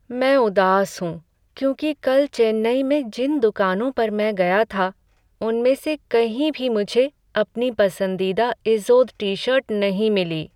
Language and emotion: Hindi, sad